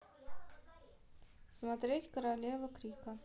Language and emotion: Russian, neutral